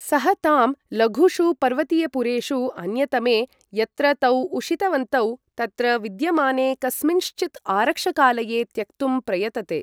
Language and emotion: Sanskrit, neutral